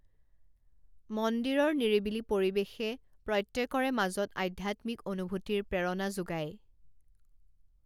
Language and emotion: Assamese, neutral